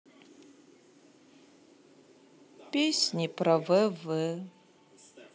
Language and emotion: Russian, sad